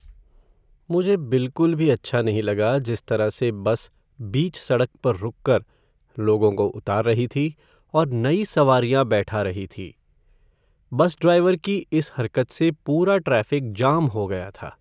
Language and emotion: Hindi, sad